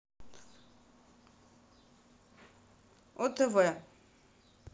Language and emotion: Russian, neutral